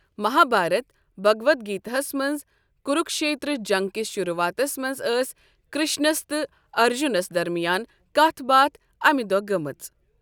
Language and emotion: Kashmiri, neutral